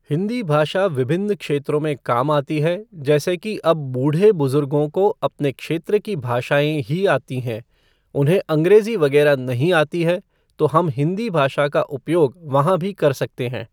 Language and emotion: Hindi, neutral